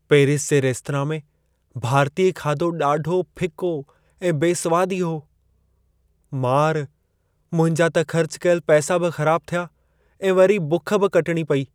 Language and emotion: Sindhi, sad